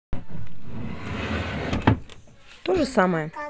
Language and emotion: Russian, neutral